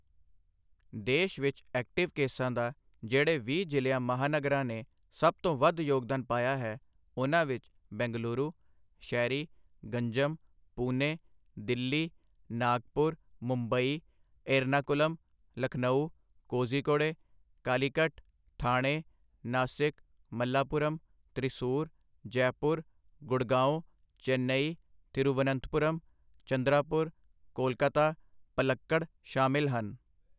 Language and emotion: Punjabi, neutral